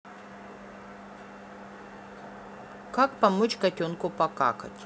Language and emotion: Russian, neutral